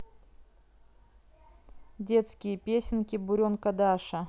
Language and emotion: Russian, neutral